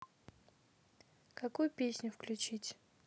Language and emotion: Russian, neutral